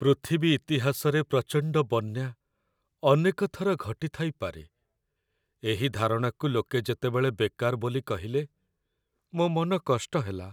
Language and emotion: Odia, sad